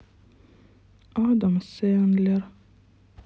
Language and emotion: Russian, sad